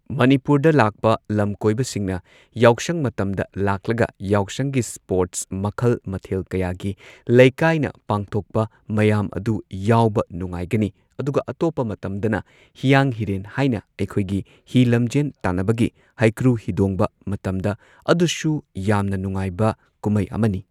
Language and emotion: Manipuri, neutral